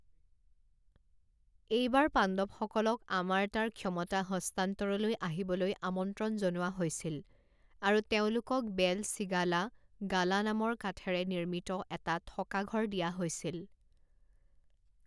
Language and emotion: Assamese, neutral